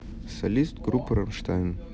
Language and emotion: Russian, neutral